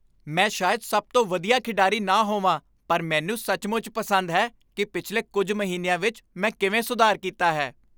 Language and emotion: Punjabi, happy